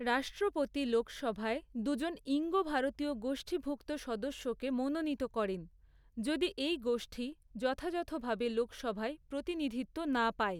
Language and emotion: Bengali, neutral